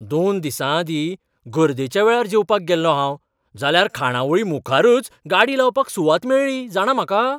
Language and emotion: Goan Konkani, surprised